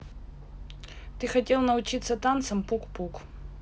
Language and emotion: Russian, neutral